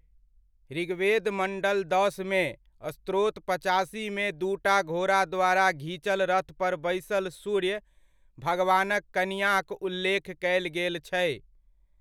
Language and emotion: Maithili, neutral